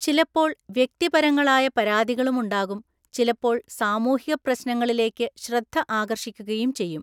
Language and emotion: Malayalam, neutral